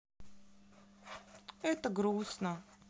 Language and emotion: Russian, sad